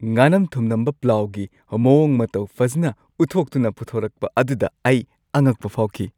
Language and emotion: Manipuri, happy